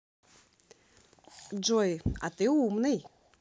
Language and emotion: Russian, positive